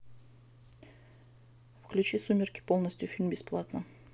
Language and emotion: Russian, neutral